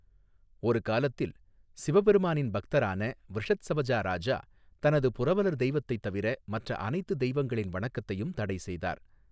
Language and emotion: Tamil, neutral